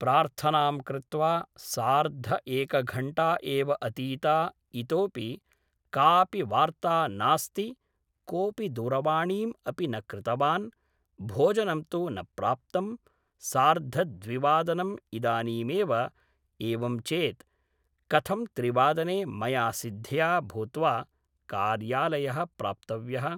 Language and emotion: Sanskrit, neutral